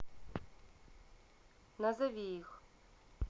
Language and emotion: Russian, neutral